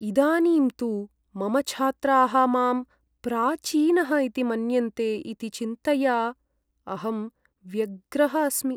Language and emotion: Sanskrit, sad